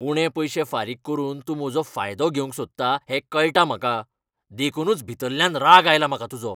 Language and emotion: Goan Konkani, angry